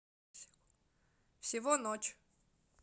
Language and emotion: Russian, neutral